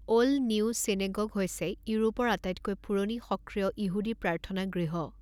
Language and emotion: Assamese, neutral